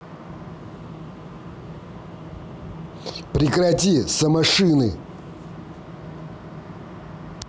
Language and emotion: Russian, angry